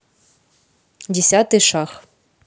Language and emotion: Russian, neutral